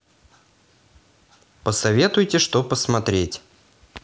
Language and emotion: Russian, positive